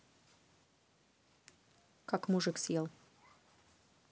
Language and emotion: Russian, neutral